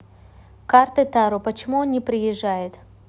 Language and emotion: Russian, neutral